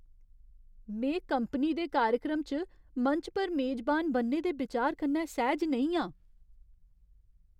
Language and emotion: Dogri, fearful